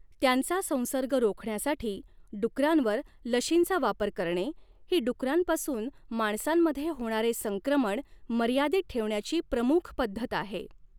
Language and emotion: Marathi, neutral